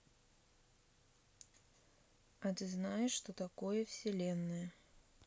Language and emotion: Russian, neutral